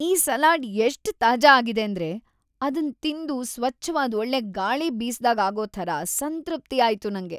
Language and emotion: Kannada, happy